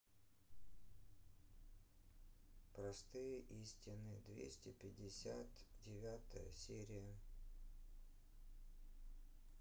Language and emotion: Russian, sad